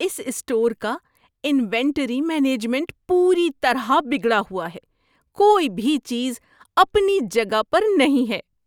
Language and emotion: Urdu, disgusted